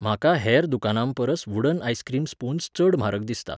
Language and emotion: Goan Konkani, neutral